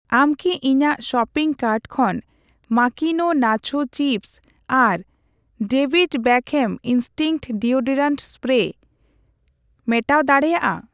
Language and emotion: Santali, neutral